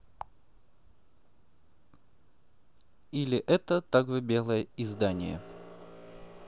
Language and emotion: Russian, neutral